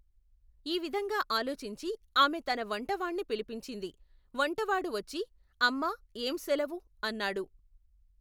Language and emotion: Telugu, neutral